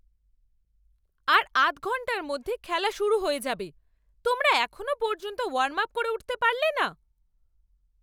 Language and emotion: Bengali, angry